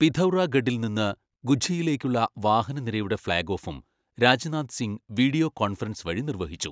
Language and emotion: Malayalam, neutral